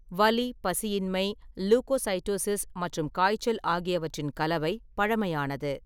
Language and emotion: Tamil, neutral